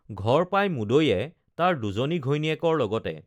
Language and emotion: Assamese, neutral